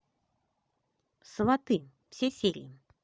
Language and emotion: Russian, positive